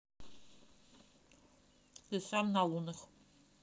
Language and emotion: Russian, neutral